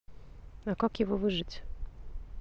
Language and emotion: Russian, neutral